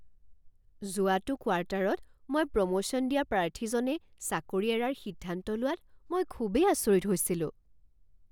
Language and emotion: Assamese, surprised